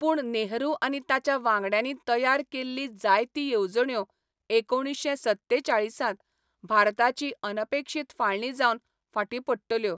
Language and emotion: Goan Konkani, neutral